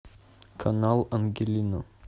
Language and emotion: Russian, neutral